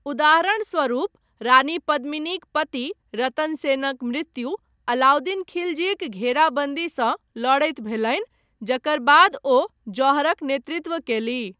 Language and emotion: Maithili, neutral